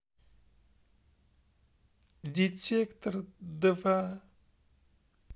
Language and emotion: Russian, sad